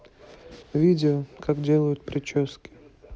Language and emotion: Russian, neutral